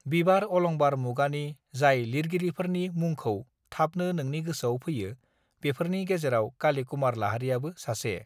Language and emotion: Bodo, neutral